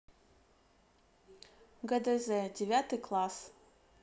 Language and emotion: Russian, neutral